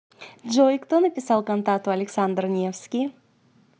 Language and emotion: Russian, positive